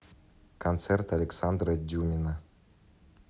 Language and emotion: Russian, neutral